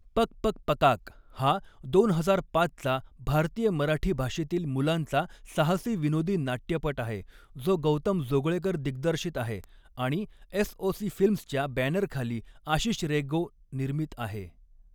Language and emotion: Marathi, neutral